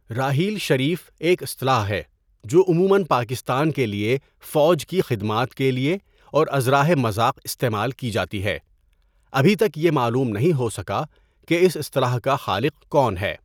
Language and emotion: Urdu, neutral